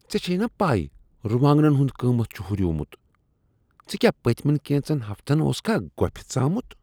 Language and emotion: Kashmiri, disgusted